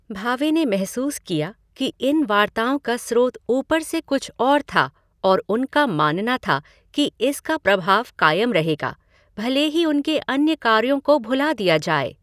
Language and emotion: Hindi, neutral